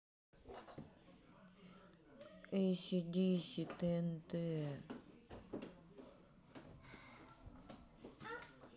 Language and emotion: Russian, sad